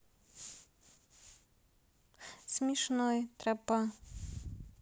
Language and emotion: Russian, neutral